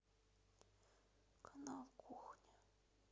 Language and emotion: Russian, sad